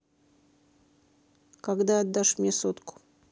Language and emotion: Russian, neutral